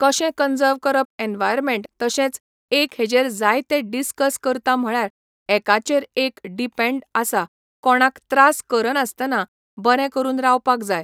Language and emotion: Goan Konkani, neutral